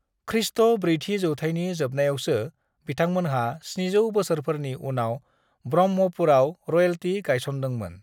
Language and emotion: Bodo, neutral